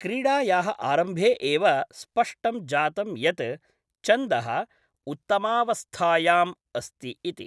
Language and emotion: Sanskrit, neutral